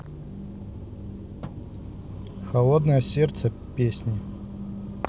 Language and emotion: Russian, neutral